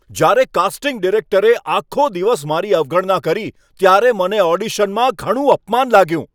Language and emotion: Gujarati, angry